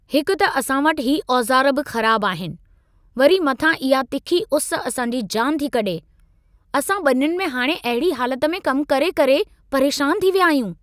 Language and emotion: Sindhi, angry